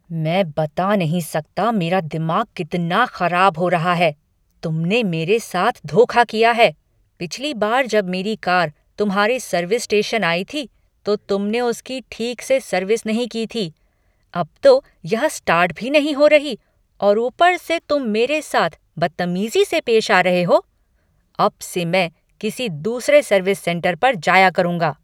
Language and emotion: Hindi, angry